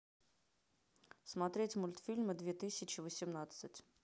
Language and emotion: Russian, neutral